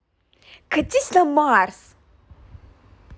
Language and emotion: Russian, angry